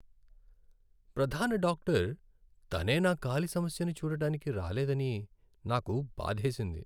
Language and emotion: Telugu, sad